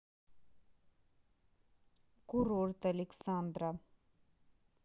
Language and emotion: Russian, neutral